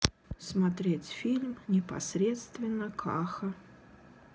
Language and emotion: Russian, sad